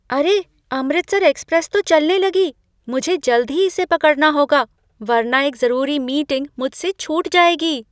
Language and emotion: Hindi, surprised